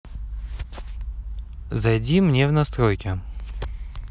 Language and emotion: Russian, neutral